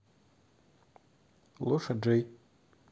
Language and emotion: Russian, neutral